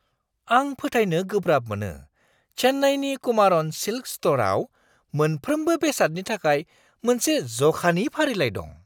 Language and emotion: Bodo, surprised